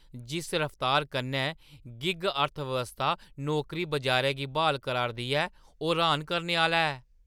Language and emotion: Dogri, surprised